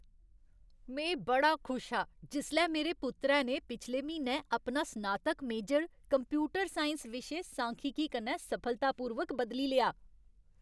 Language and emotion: Dogri, happy